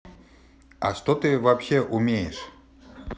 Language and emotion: Russian, angry